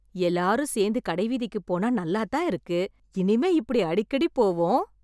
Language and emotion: Tamil, happy